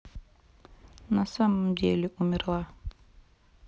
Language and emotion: Russian, sad